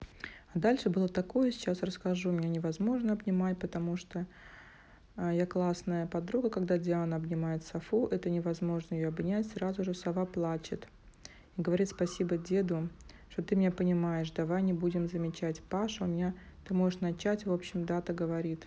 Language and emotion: Russian, neutral